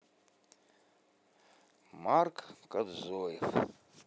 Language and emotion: Russian, neutral